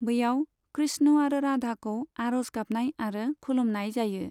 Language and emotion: Bodo, neutral